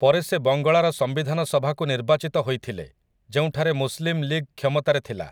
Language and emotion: Odia, neutral